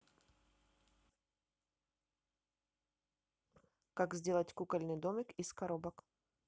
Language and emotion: Russian, neutral